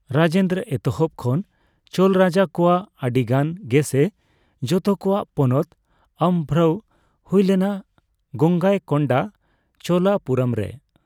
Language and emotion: Santali, neutral